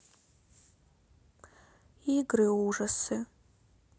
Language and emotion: Russian, sad